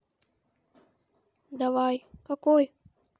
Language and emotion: Russian, neutral